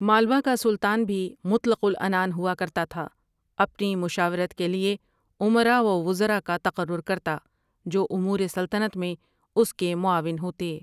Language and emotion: Urdu, neutral